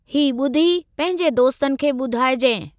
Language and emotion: Sindhi, neutral